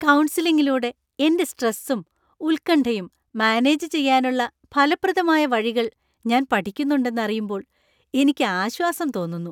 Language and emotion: Malayalam, happy